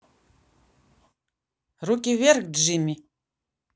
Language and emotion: Russian, neutral